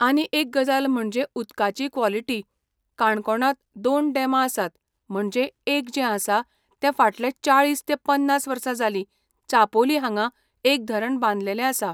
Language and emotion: Goan Konkani, neutral